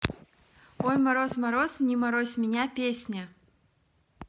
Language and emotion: Russian, neutral